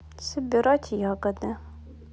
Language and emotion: Russian, neutral